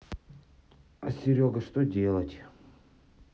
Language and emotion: Russian, sad